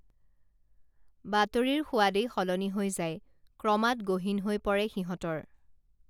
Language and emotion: Assamese, neutral